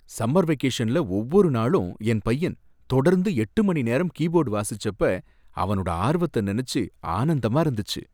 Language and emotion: Tamil, happy